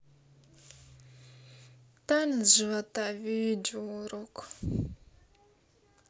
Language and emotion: Russian, sad